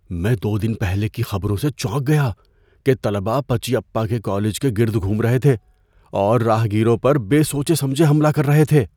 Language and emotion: Urdu, fearful